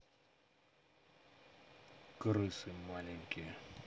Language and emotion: Russian, angry